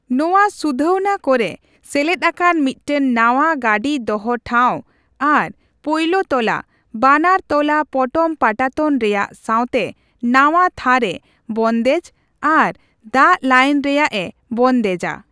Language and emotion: Santali, neutral